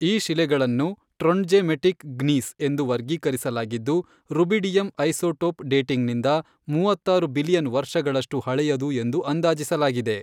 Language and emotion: Kannada, neutral